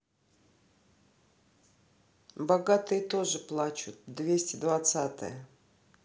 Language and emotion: Russian, neutral